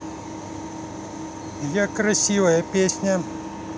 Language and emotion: Russian, positive